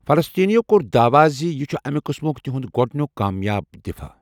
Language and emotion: Kashmiri, neutral